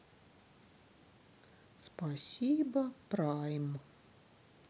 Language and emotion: Russian, sad